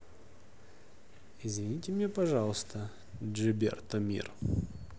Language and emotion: Russian, neutral